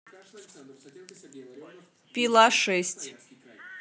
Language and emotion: Russian, neutral